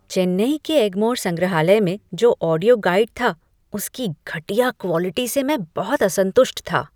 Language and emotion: Hindi, disgusted